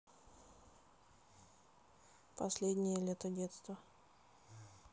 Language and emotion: Russian, neutral